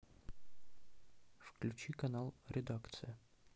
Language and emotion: Russian, neutral